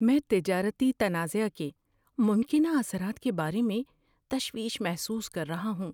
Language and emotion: Urdu, fearful